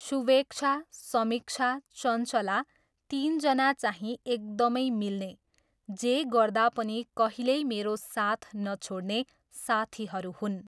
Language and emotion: Nepali, neutral